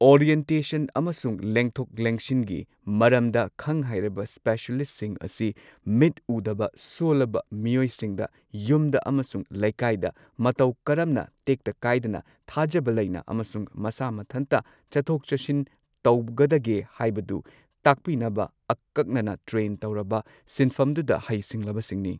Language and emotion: Manipuri, neutral